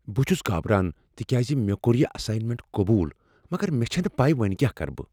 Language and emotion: Kashmiri, fearful